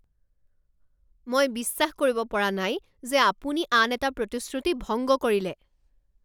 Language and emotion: Assamese, angry